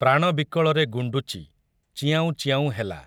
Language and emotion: Odia, neutral